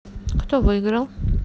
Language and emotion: Russian, neutral